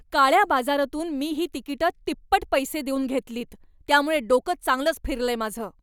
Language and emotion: Marathi, angry